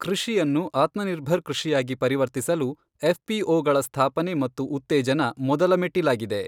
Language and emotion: Kannada, neutral